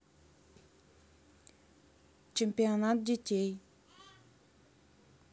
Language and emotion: Russian, neutral